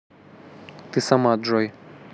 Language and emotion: Russian, neutral